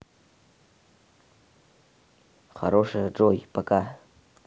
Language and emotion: Russian, neutral